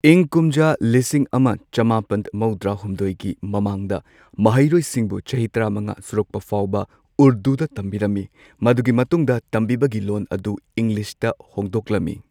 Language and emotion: Manipuri, neutral